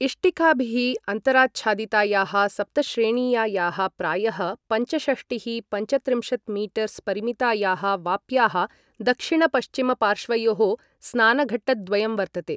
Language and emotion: Sanskrit, neutral